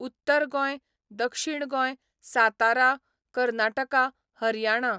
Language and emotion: Goan Konkani, neutral